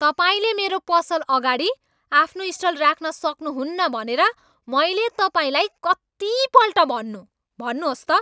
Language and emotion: Nepali, angry